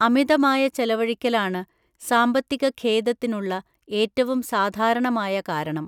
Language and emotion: Malayalam, neutral